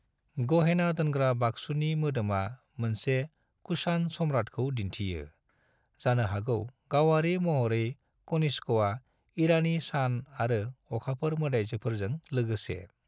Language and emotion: Bodo, neutral